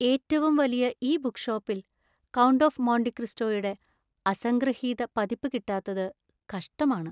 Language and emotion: Malayalam, sad